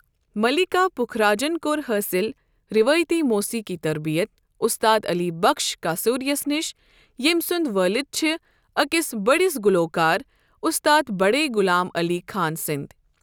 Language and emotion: Kashmiri, neutral